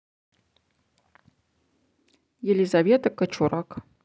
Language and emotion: Russian, neutral